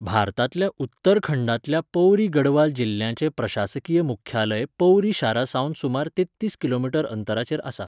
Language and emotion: Goan Konkani, neutral